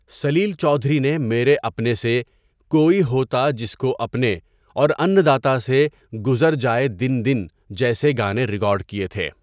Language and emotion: Urdu, neutral